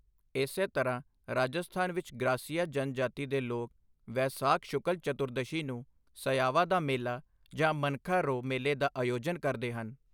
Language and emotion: Punjabi, neutral